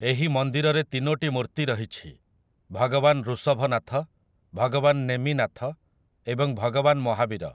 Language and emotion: Odia, neutral